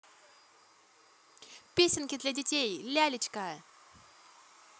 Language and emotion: Russian, positive